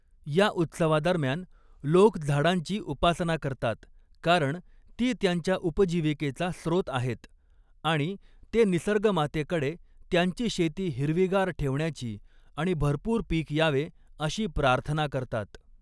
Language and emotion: Marathi, neutral